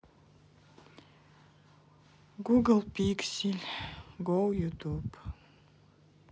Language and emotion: Russian, sad